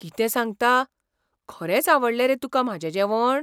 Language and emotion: Goan Konkani, surprised